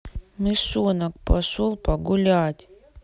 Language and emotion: Russian, sad